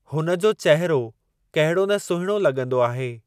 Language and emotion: Sindhi, neutral